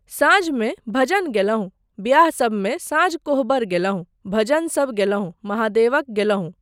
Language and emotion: Maithili, neutral